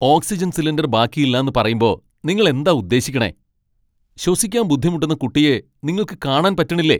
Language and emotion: Malayalam, angry